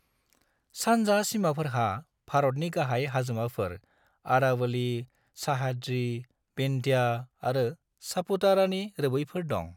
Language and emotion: Bodo, neutral